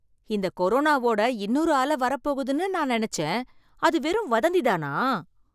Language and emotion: Tamil, surprised